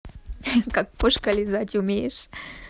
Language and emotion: Russian, positive